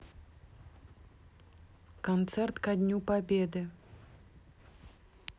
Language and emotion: Russian, neutral